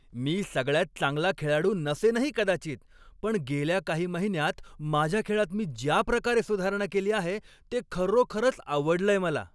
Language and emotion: Marathi, happy